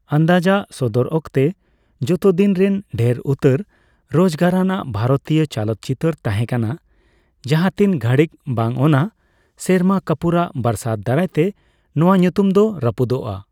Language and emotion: Santali, neutral